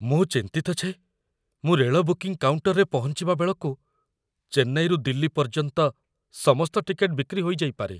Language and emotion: Odia, fearful